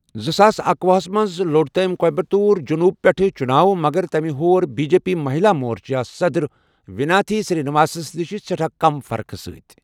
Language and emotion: Kashmiri, neutral